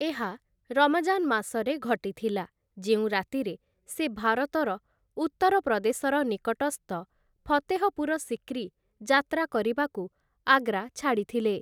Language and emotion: Odia, neutral